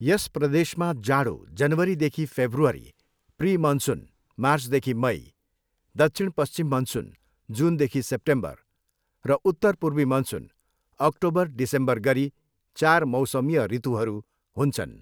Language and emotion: Nepali, neutral